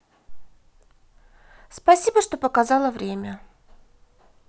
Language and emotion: Russian, positive